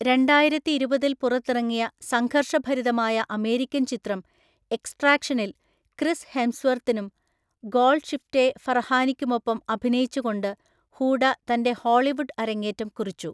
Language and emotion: Malayalam, neutral